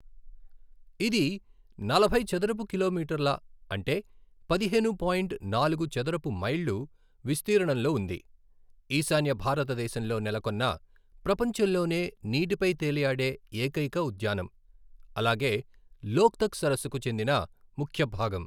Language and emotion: Telugu, neutral